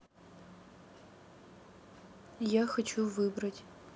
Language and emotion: Russian, neutral